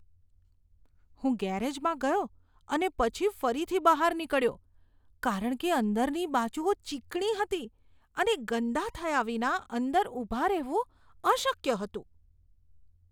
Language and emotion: Gujarati, disgusted